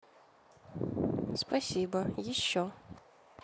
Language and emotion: Russian, neutral